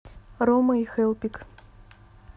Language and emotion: Russian, neutral